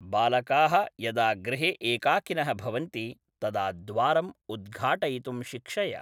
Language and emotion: Sanskrit, neutral